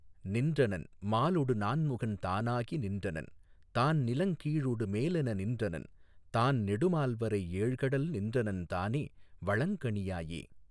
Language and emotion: Tamil, neutral